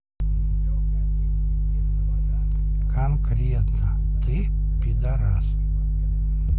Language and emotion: Russian, neutral